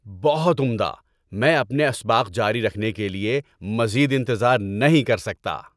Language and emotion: Urdu, happy